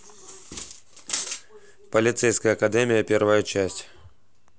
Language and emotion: Russian, neutral